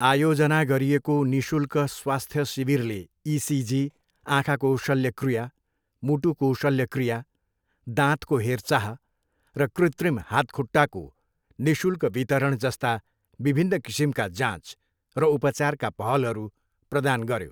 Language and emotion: Nepali, neutral